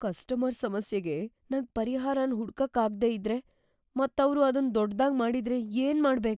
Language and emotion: Kannada, fearful